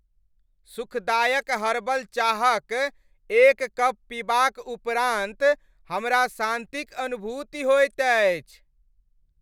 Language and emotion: Maithili, happy